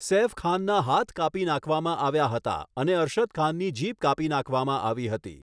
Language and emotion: Gujarati, neutral